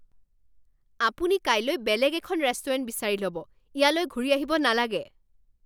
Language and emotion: Assamese, angry